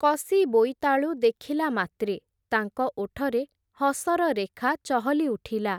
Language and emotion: Odia, neutral